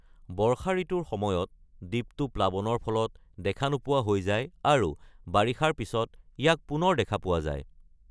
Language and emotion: Assamese, neutral